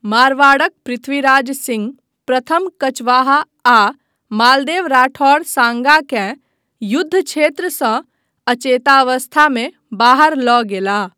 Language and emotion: Maithili, neutral